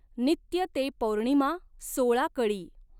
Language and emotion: Marathi, neutral